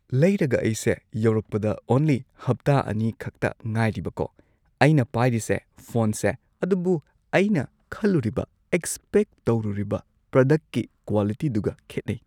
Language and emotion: Manipuri, neutral